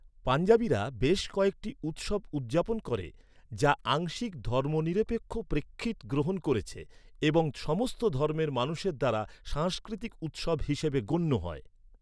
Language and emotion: Bengali, neutral